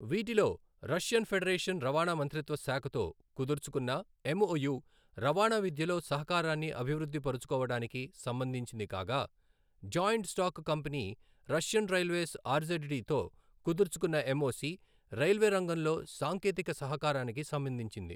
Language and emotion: Telugu, neutral